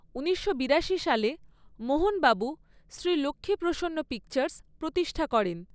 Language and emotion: Bengali, neutral